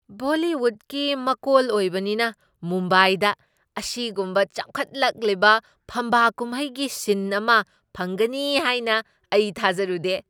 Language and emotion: Manipuri, surprised